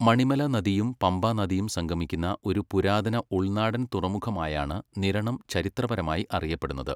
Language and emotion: Malayalam, neutral